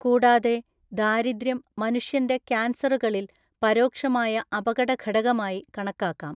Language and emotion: Malayalam, neutral